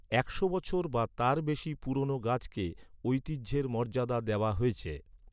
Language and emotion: Bengali, neutral